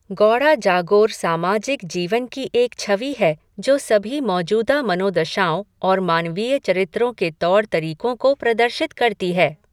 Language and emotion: Hindi, neutral